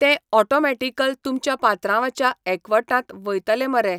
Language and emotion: Goan Konkani, neutral